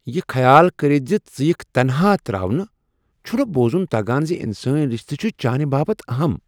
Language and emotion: Kashmiri, surprised